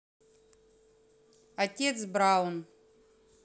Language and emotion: Russian, neutral